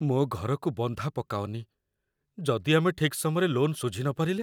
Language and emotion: Odia, fearful